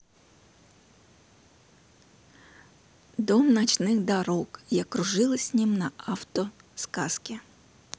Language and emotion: Russian, neutral